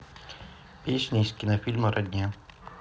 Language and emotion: Russian, neutral